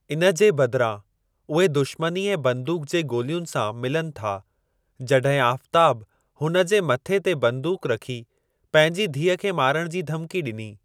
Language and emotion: Sindhi, neutral